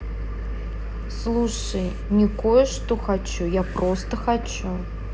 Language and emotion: Russian, neutral